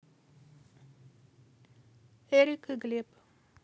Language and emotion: Russian, neutral